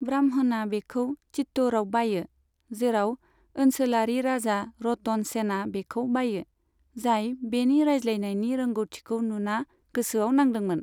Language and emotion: Bodo, neutral